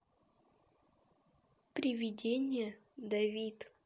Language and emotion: Russian, neutral